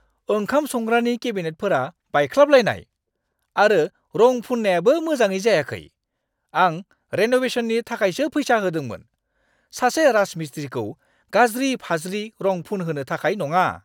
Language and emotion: Bodo, angry